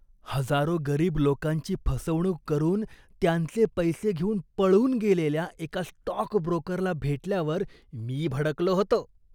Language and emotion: Marathi, disgusted